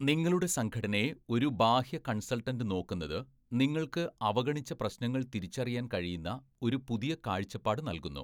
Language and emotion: Malayalam, neutral